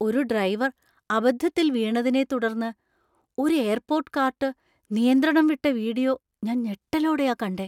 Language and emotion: Malayalam, surprised